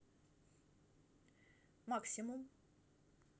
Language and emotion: Russian, neutral